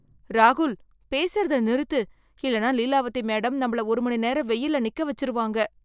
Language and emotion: Tamil, fearful